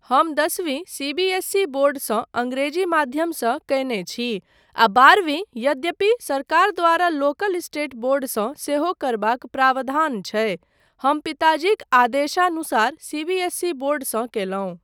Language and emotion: Maithili, neutral